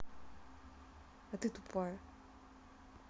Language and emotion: Russian, angry